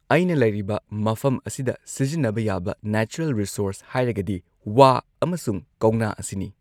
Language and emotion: Manipuri, neutral